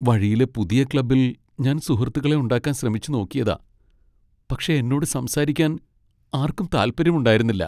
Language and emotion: Malayalam, sad